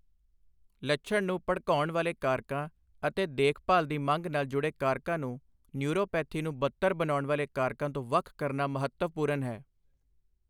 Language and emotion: Punjabi, neutral